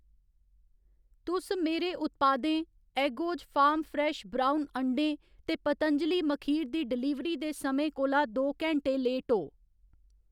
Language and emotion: Dogri, neutral